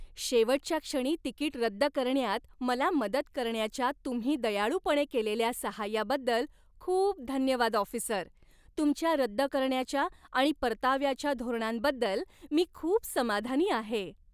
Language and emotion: Marathi, happy